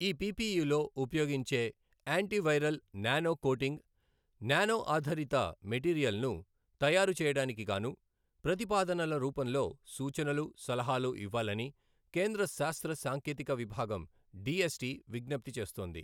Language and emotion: Telugu, neutral